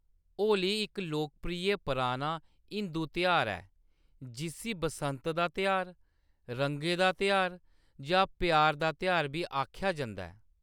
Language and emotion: Dogri, neutral